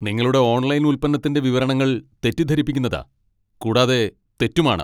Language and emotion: Malayalam, angry